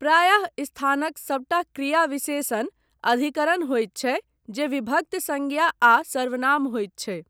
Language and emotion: Maithili, neutral